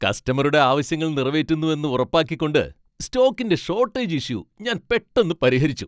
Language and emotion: Malayalam, happy